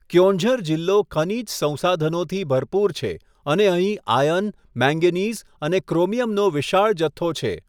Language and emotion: Gujarati, neutral